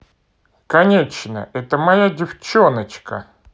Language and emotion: Russian, positive